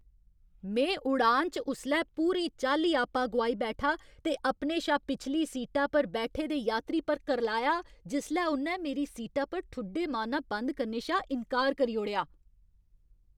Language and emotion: Dogri, angry